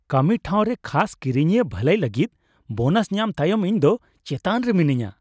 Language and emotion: Santali, happy